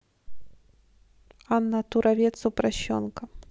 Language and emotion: Russian, neutral